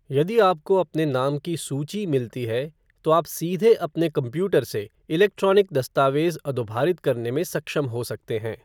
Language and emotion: Hindi, neutral